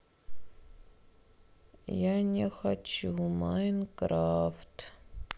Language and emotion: Russian, sad